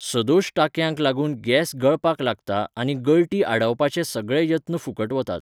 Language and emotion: Goan Konkani, neutral